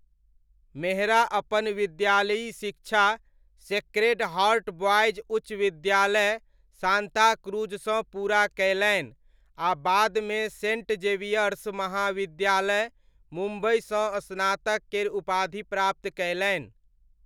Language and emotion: Maithili, neutral